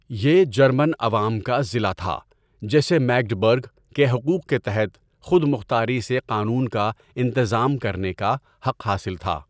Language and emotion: Urdu, neutral